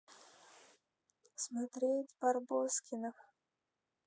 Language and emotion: Russian, sad